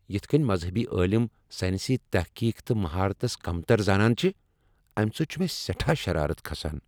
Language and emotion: Kashmiri, angry